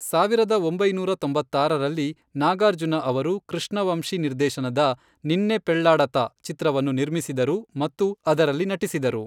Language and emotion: Kannada, neutral